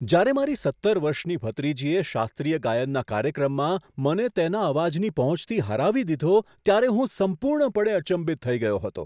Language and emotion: Gujarati, surprised